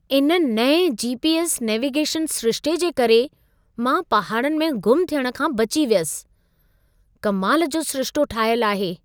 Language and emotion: Sindhi, surprised